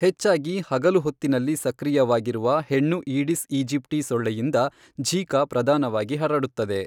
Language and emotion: Kannada, neutral